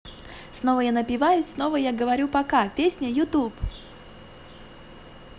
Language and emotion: Russian, positive